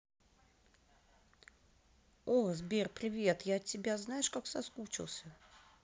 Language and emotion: Russian, positive